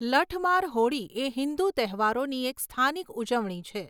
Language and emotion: Gujarati, neutral